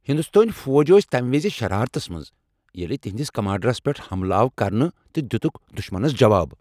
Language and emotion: Kashmiri, angry